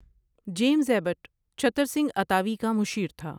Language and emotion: Urdu, neutral